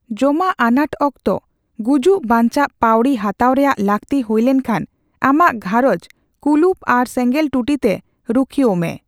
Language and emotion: Santali, neutral